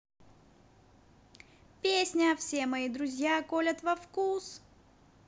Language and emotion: Russian, positive